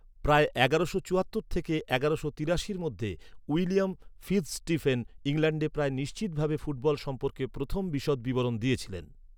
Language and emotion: Bengali, neutral